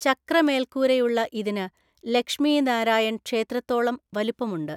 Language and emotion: Malayalam, neutral